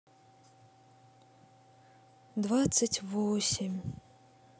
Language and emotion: Russian, sad